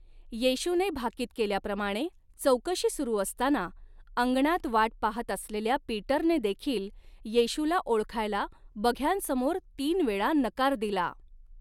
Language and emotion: Marathi, neutral